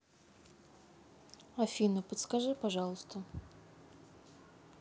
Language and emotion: Russian, neutral